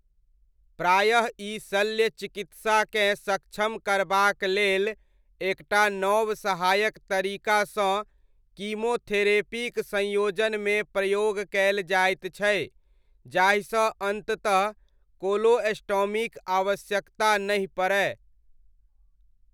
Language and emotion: Maithili, neutral